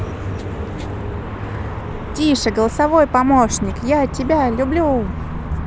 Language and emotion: Russian, positive